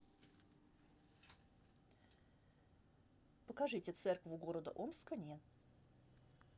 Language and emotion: Russian, neutral